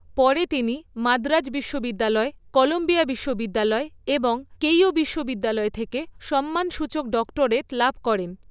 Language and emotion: Bengali, neutral